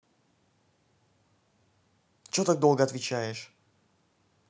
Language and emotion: Russian, angry